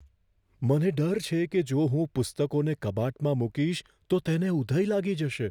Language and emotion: Gujarati, fearful